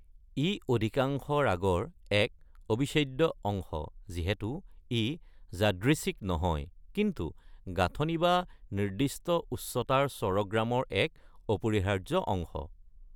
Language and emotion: Assamese, neutral